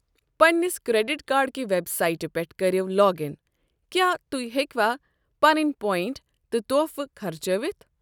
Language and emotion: Kashmiri, neutral